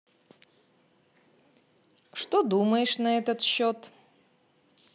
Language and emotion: Russian, positive